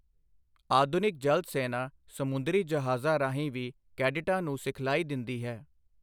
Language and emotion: Punjabi, neutral